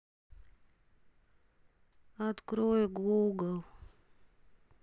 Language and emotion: Russian, sad